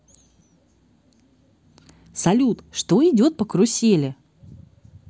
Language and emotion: Russian, positive